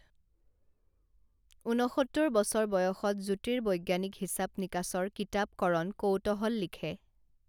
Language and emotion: Assamese, neutral